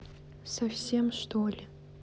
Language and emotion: Russian, sad